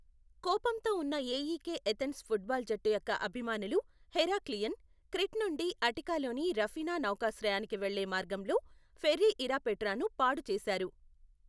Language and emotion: Telugu, neutral